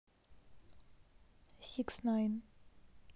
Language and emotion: Russian, neutral